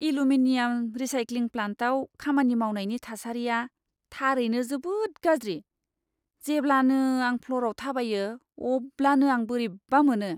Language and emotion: Bodo, disgusted